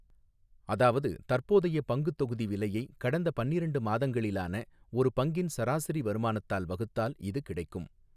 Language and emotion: Tamil, neutral